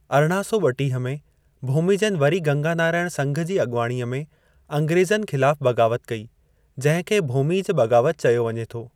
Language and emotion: Sindhi, neutral